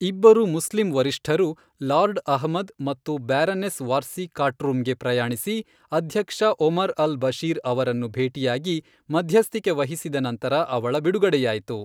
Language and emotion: Kannada, neutral